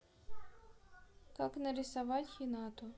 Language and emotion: Russian, neutral